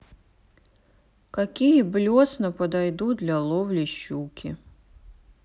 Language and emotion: Russian, sad